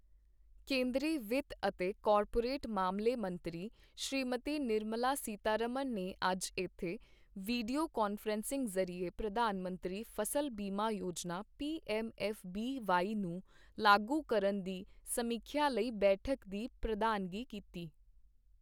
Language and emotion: Punjabi, neutral